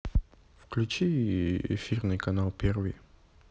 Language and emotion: Russian, neutral